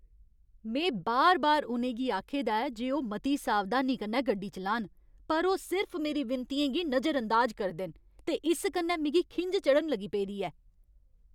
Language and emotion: Dogri, angry